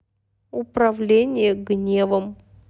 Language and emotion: Russian, neutral